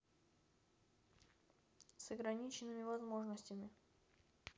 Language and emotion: Russian, neutral